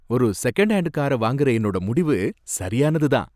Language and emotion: Tamil, happy